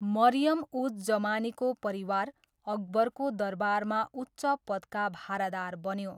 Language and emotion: Nepali, neutral